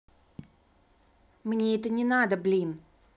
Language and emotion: Russian, angry